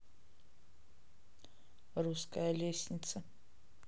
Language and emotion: Russian, neutral